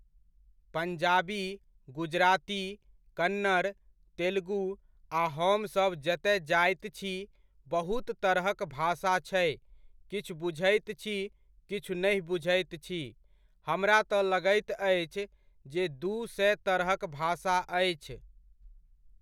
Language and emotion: Maithili, neutral